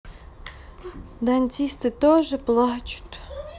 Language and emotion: Russian, sad